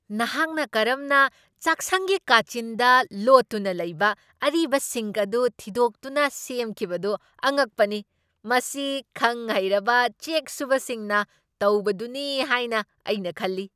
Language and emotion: Manipuri, surprised